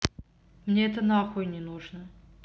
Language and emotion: Russian, angry